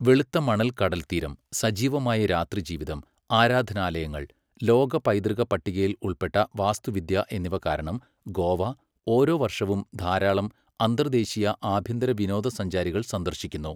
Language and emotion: Malayalam, neutral